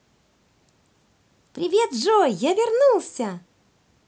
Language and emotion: Russian, positive